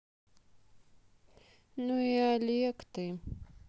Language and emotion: Russian, sad